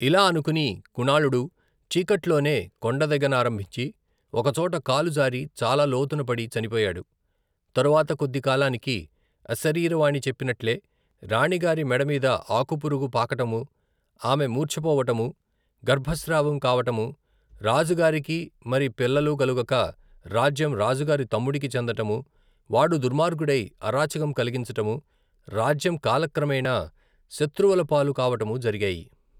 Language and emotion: Telugu, neutral